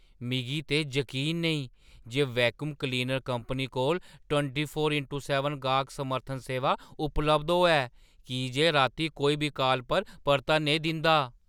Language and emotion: Dogri, surprised